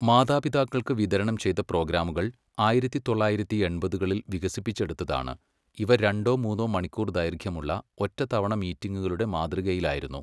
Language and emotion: Malayalam, neutral